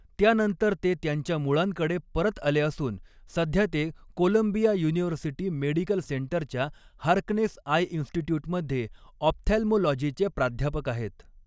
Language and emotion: Marathi, neutral